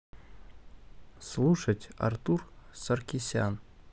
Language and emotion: Russian, neutral